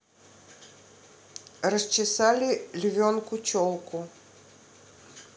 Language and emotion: Russian, neutral